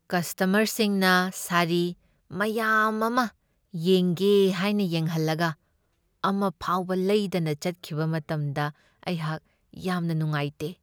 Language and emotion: Manipuri, sad